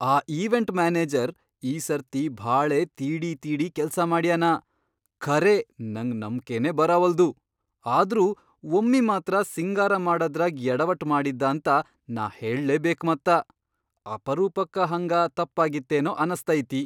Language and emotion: Kannada, surprised